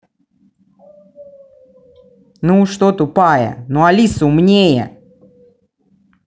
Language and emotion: Russian, angry